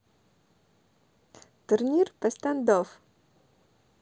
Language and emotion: Russian, positive